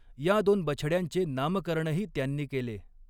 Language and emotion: Marathi, neutral